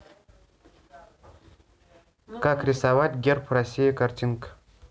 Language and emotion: Russian, neutral